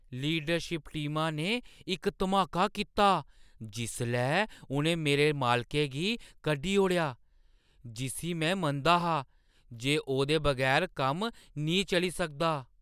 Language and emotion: Dogri, surprised